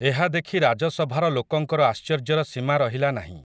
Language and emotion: Odia, neutral